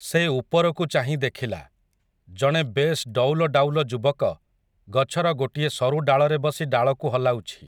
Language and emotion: Odia, neutral